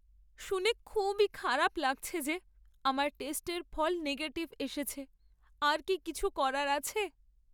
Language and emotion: Bengali, sad